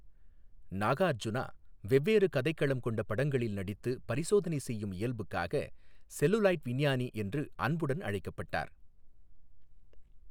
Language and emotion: Tamil, neutral